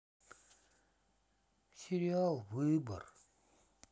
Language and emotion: Russian, sad